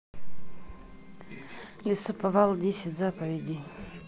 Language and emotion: Russian, neutral